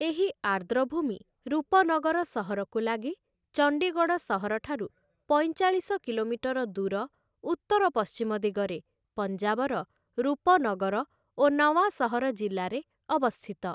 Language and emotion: Odia, neutral